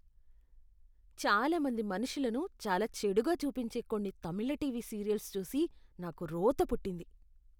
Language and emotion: Telugu, disgusted